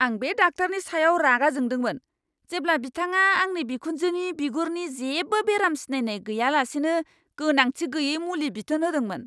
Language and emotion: Bodo, angry